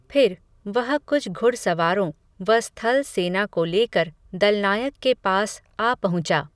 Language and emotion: Hindi, neutral